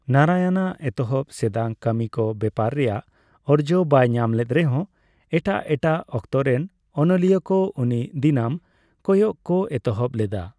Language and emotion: Santali, neutral